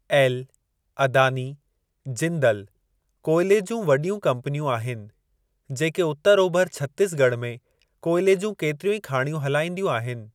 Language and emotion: Sindhi, neutral